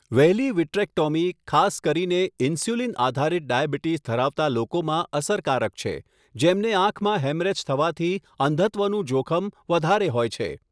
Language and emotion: Gujarati, neutral